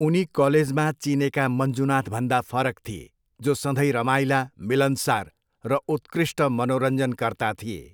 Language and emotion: Nepali, neutral